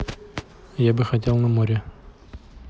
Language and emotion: Russian, neutral